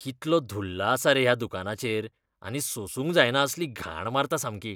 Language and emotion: Goan Konkani, disgusted